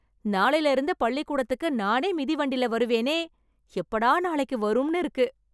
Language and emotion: Tamil, happy